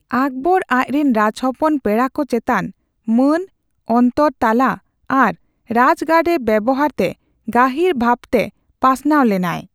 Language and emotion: Santali, neutral